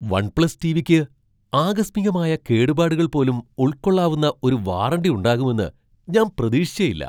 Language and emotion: Malayalam, surprised